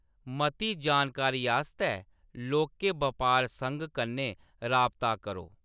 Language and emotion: Dogri, neutral